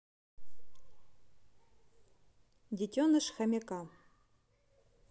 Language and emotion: Russian, neutral